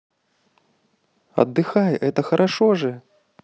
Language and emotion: Russian, positive